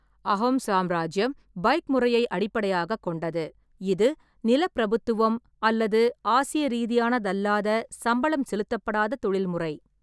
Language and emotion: Tamil, neutral